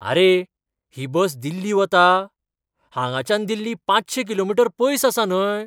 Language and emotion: Goan Konkani, surprised